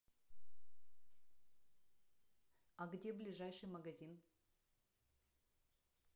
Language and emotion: Russian, neutral